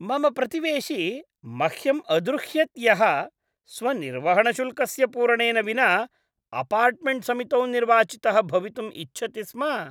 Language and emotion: Sanskrit, disgusted